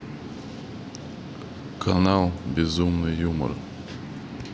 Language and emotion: Russian, neutral